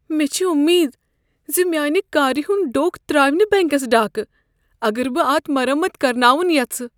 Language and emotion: Kashmiri, fearful